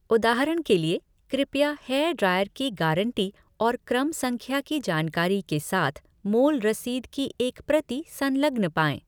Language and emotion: Hindi, neutral